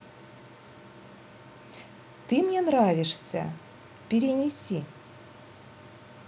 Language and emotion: Russian, positive